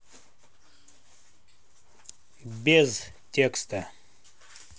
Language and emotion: Russian, neutral